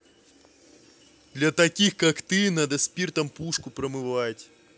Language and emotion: Russian, angry